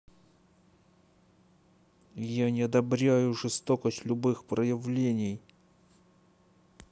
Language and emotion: Russian, angry